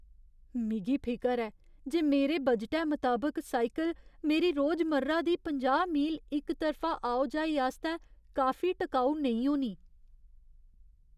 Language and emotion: Dogri, fearful